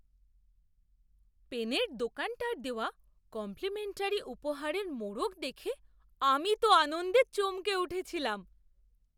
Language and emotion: Bengali, surprised